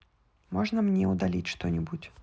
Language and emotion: Russian, neutral